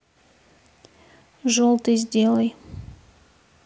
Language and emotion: Russian, neutral